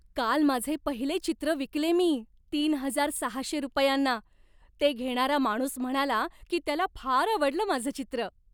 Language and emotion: Marathi, happy